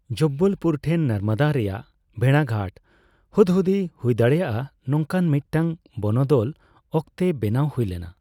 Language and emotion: Santali, neutral